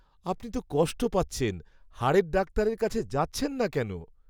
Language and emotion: Bengali, sad